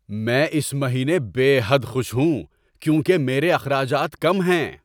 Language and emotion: Urdu, happy